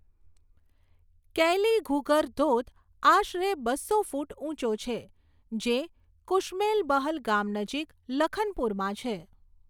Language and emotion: Gujarati, neutral